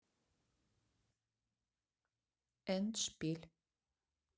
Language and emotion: Russian, neutral